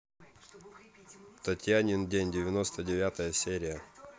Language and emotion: Russian, neutral